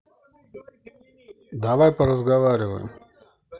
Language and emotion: Russian, neutral